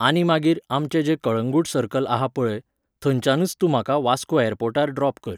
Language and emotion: Goan Konkani, neutral